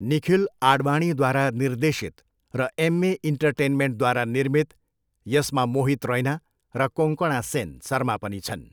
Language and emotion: Nepali, neutral